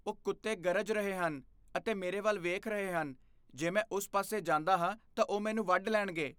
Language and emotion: Punjabi, fearful